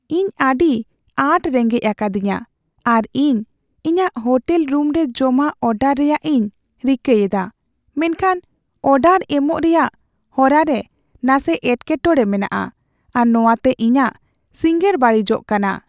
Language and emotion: Santali, sad